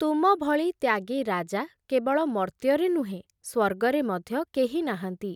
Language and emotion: Odia, neutral